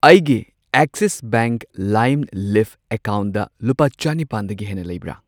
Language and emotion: Manipuri, neutral